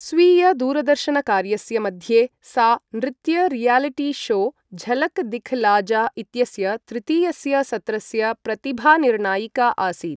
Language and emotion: Sanskrit, neutral